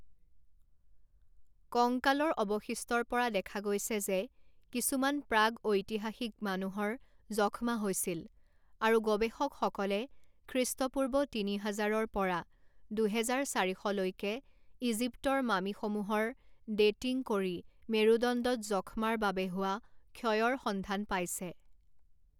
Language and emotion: Assamese, neutral